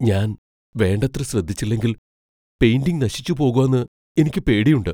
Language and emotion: Malayalam, fearful